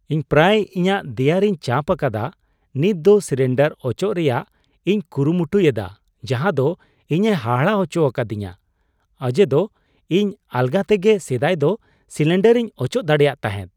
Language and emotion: Santali, surprised